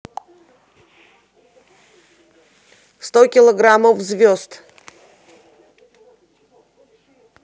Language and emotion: Russian, neutral